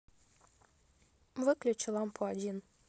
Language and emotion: Russian, neutral